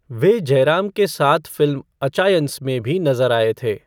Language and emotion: Hindi, neutral